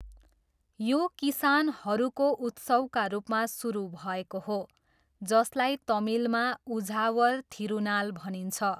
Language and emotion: Nepali, neutral